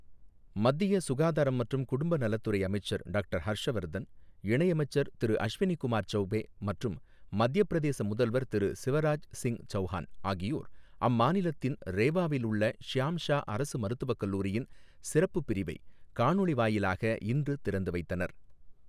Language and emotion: Tamil, neutral